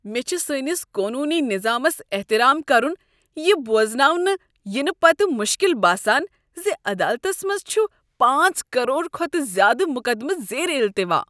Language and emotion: Kashmiri, disgusted